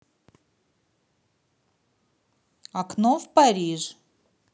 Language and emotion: Russian, neutral